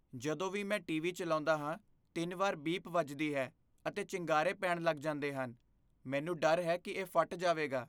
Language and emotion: Punjabi, fearful